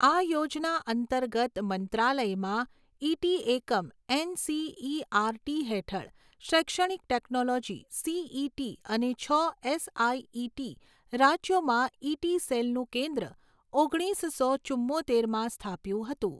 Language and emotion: Gujarati, neutral